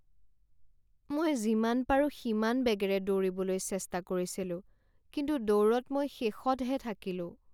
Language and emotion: Assamese, sad